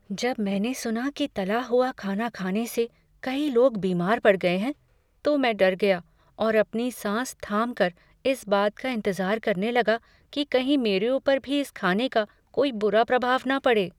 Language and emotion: Hindi, fearful